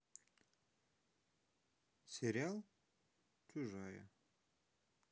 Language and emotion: Russian, neutral